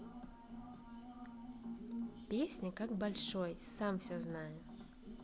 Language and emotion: Russian, positive